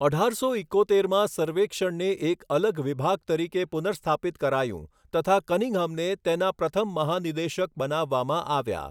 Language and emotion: Gujarati, neutral